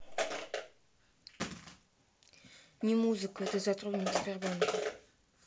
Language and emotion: Russian, neutral